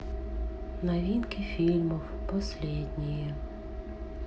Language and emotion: Russian, sad